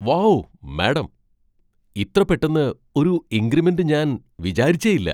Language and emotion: Malayalam, surprised